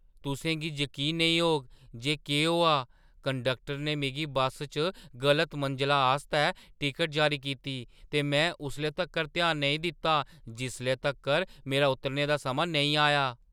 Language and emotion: Dogri, surprised